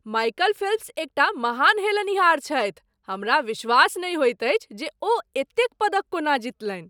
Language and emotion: Maithili, surprised